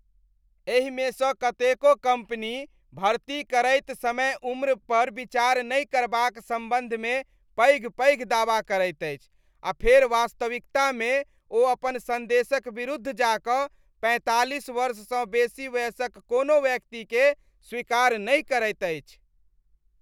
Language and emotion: Maithili, disgusted